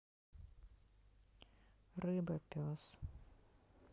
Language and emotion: Russian, sad